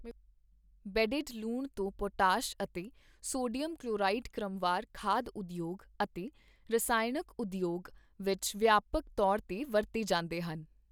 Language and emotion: Punjabi, neutral